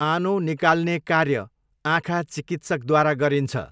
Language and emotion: Nepali, neutral